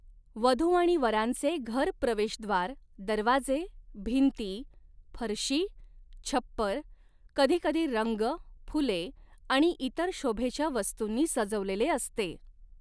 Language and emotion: Marathi, neutral